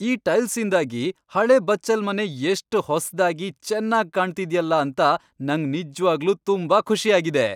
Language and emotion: Kannada, happy